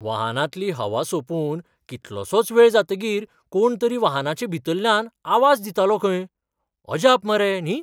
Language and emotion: Goan Konkani, surprised